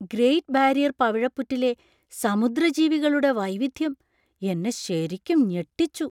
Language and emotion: Malayalam, surprised